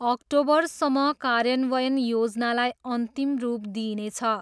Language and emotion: Nepali, neutral